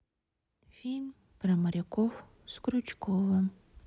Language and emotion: Russian, sad